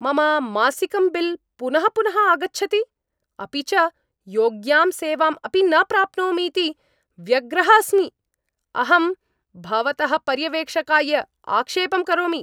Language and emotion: Sanskrit, angry